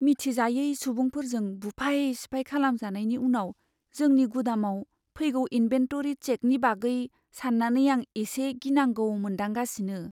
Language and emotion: Bodo, fearful